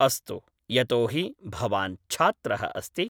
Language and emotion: Sanskrit, neutral